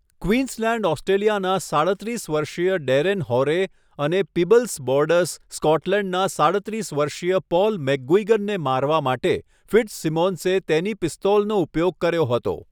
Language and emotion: Gujarati, neutral